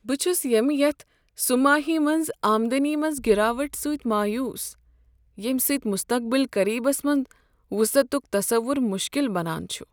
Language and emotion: Kashmiri, sad